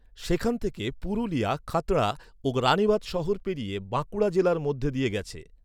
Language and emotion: Bengali, neutral